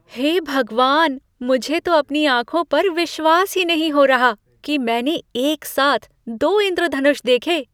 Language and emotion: Hindi, surprised